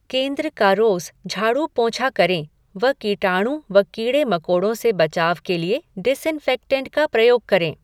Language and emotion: Hindi, neutral